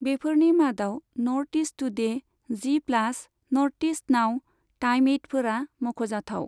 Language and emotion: Bodo, neutral